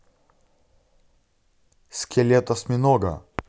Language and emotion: Russian, neutral